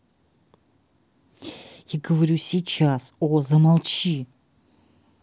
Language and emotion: Russian, angry